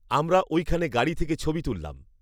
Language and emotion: Bengali, neutral